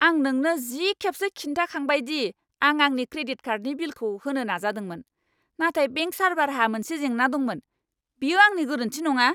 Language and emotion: Bodo, angry